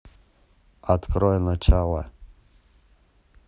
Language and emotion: Russian, neutral